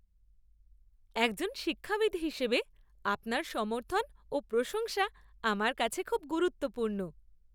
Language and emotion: Bengali, happy